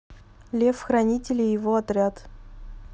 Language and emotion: Russian, neutral